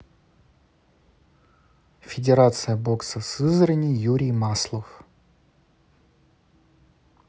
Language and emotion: Russian, neutral